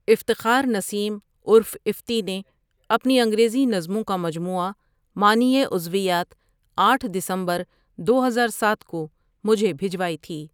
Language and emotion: Urdu, neutral